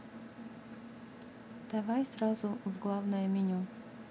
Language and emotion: Russian, neutral